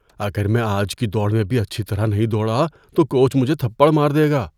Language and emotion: Urdu, fearful